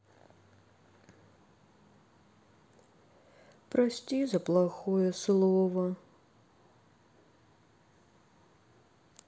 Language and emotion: Russian, sad